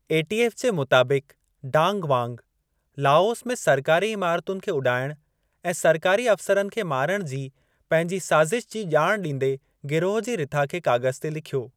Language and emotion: Sindhi, neutral